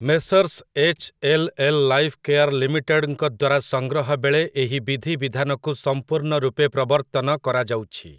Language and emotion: Odia, neutral